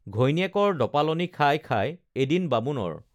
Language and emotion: Assamese, neutral